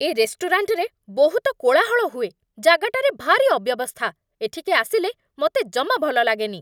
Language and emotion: Odia, angry